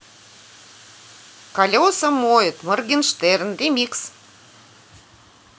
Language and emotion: Russian, positive